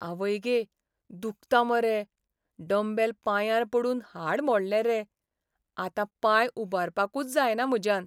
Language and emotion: Goan Konkani, sad